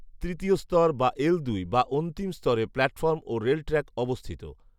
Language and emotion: Bengali, neutral